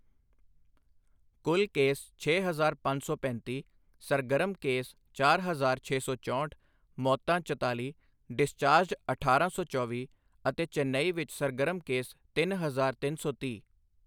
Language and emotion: Punjabi, neutral